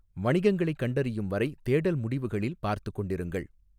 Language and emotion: Tamil, neutral